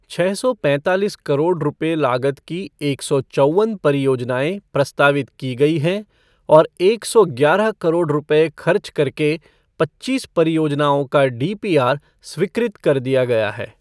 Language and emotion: Hindi, neutral